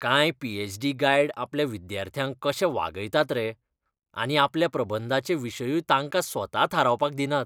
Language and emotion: Goan Konkani, disgusted